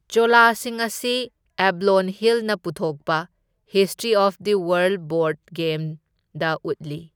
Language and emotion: Manipuri, neutral